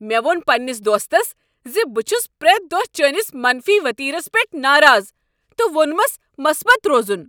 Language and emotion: Kashmiri, angry